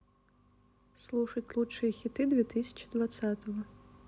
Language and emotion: Russian, neutral